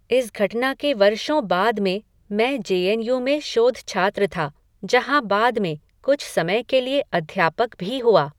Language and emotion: Hindi, neutral